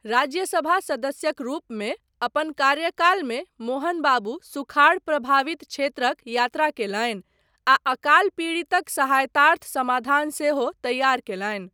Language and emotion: Maithili, neutral